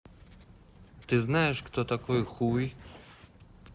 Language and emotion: Russian, neutral